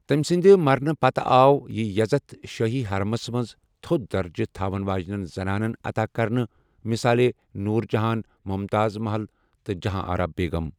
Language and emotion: Kashmiri, neutral